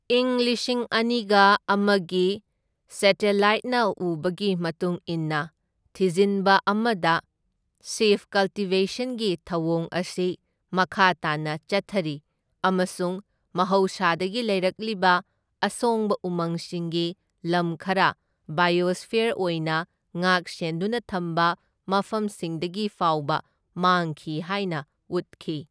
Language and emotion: Manipuri, neutral